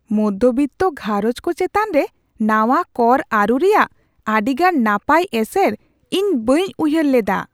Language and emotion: Santali, surprised